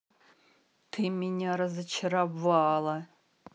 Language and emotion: Russian, angry